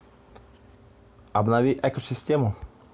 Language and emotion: Russian, neutral